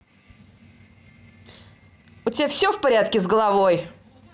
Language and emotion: Russian, angry